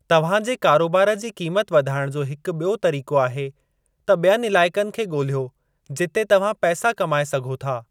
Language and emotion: Sindhi, neutral